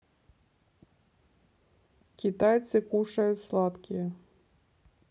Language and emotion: Russian, neutral